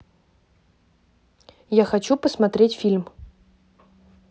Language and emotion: Russian, neutral